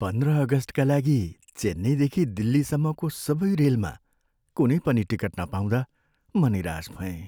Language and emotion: Nepali, sad